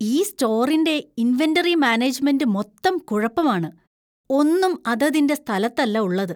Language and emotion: Malayalam, disgusted